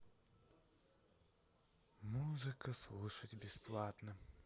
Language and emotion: Russian, sad